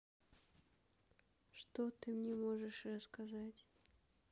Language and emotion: Russian, neutral